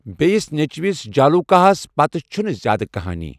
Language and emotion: Kashmiri, neutral